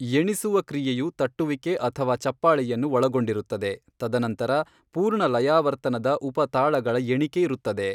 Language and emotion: Kannada, neutral